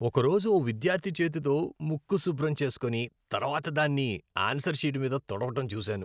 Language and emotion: Telugu, disgusted